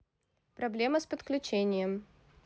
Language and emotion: Russian, neutral